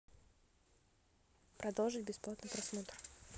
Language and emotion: Russian, neutral